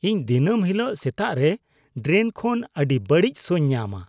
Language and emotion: Santali, disgusted